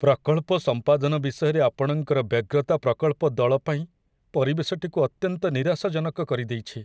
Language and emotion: Odia, sad